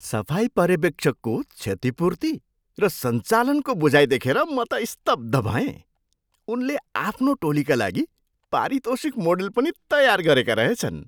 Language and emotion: Nepali, surprised